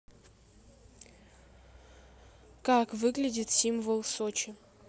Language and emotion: Russian, neutral